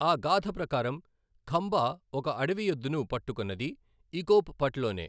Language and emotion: Telugu, neutral